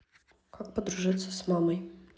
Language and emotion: Russian, neutral